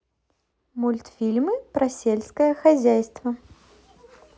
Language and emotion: Russian, positive